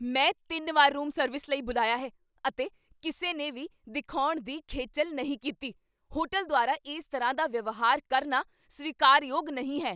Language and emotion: Punjabi, angry